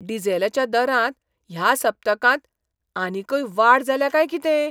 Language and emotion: Goan Konkani, surprised